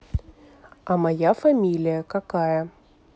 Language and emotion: Russian, neutral